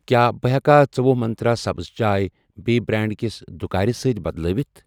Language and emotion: Kashmiri, neutral